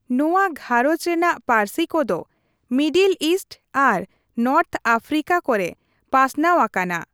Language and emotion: Santali, neutral